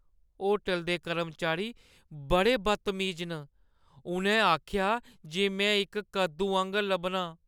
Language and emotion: Dogri, sad